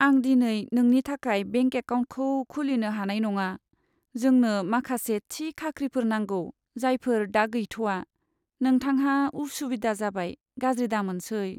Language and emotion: Bodo, sad